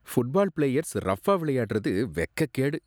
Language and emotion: Tamil, disgusted